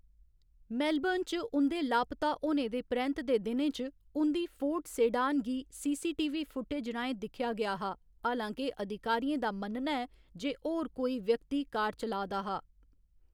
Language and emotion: Dogri, neutral